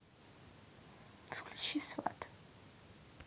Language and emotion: Russian, neutral